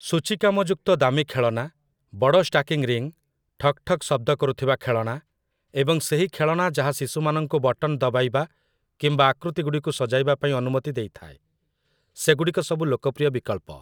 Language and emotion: Odia, neutral